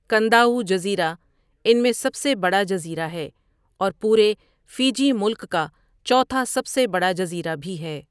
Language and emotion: Urdu, neutral